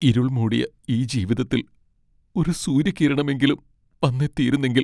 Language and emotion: Malayalam, sad